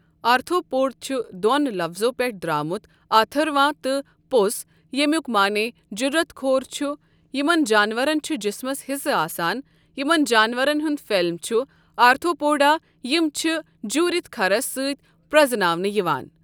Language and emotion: Kashmiri, neutral